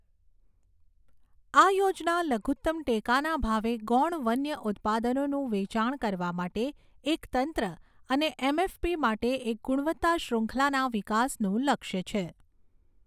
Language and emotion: Gujarati, neutral